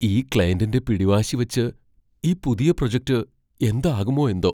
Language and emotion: Malayalam, fearful